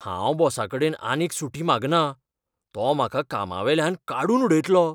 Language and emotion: Goan Konkani, fearful